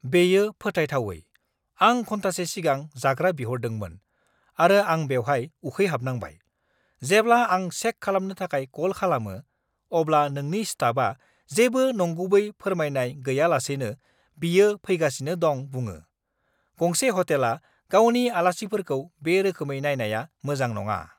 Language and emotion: Bodo, angry